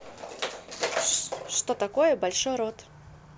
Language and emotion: Russian, neutral